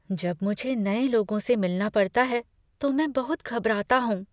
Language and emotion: Hindi, fearful